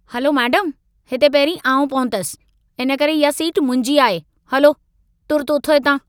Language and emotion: Sindhi, angry